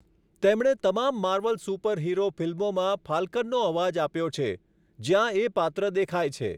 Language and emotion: Gujarati, neutral